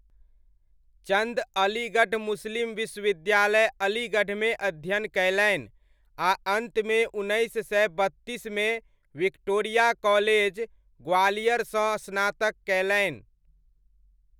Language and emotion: Maithili, neutral